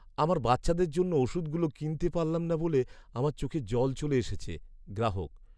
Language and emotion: Bengali, sad